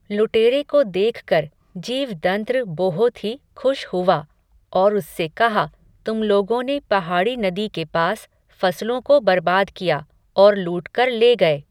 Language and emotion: Hindi, neutral